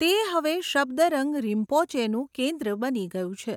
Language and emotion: Gujarati, neutral